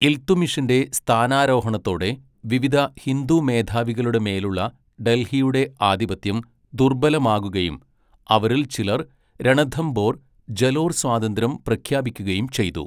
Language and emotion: Malayalam, neutral